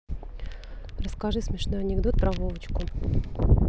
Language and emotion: Russian, neutral